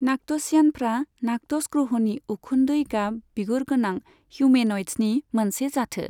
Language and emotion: Bodo, neutral